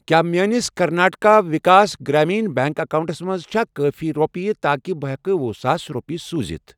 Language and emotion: Kashmiri, neutral